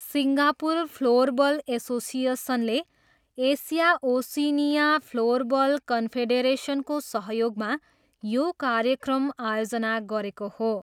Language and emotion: Nepali, neutral